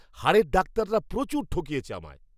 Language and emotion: Bengali, angry